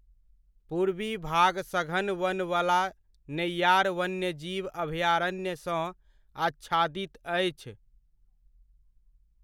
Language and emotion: Maithili, neutral